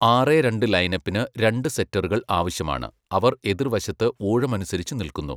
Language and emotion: Malayalam, neutral